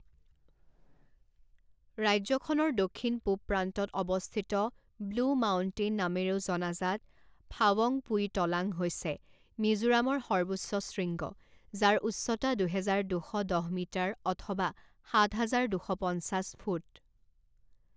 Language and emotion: Assamese, neutral